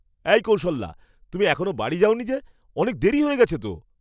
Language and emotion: Bengali, surprised